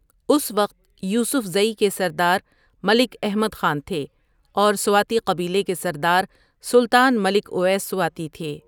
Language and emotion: Urdu, neutral